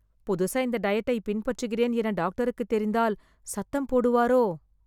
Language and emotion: Tamil, fearful